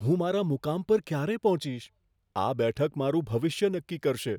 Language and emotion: Gujarati, fearful